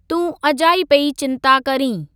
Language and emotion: Sindhi, neutral